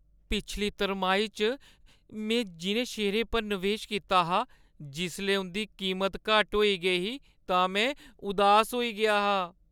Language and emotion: Dogri, sad